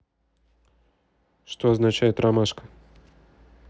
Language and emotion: Russian, neutral